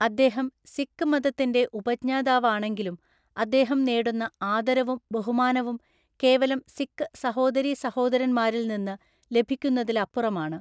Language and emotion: Malayalam, neutral